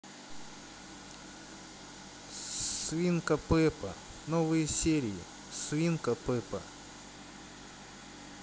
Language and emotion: Russian, neutral